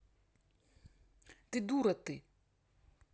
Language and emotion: Russian, angry